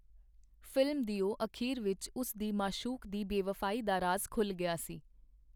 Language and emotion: Punjabi, neutral